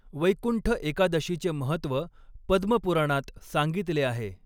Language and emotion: Marathi, neutral